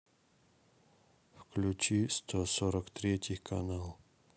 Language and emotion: Russian, neutral